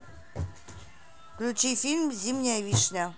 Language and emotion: Russian, neutral